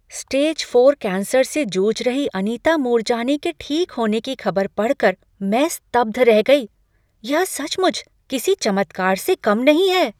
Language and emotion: Hindi, surprised